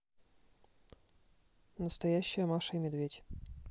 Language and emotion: Russian, neutral